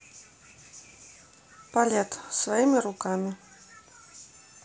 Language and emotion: Russian, neutral